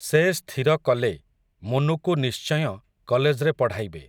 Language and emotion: Odia, neutral